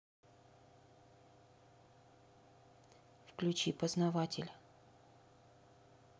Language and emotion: Russian, neutral